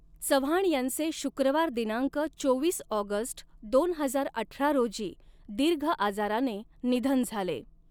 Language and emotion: Marathi, neutral